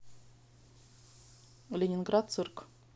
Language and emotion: Russian, neutral